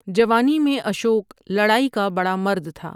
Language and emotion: Urdu, neutral